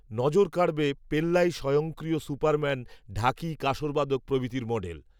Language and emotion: Bengali, neutral